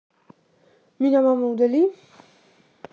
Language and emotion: Russian, neutral